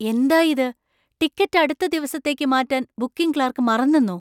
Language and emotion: Malayalam, surprised